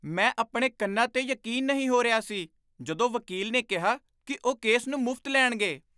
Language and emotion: Punjabi, surprised